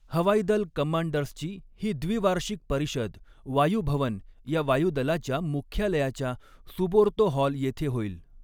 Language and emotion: Marathi, neutral